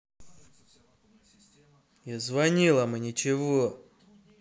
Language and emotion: Russian, angry